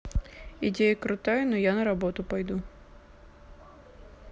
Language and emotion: Russian, neutral